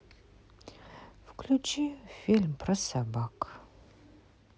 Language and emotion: Russian, sad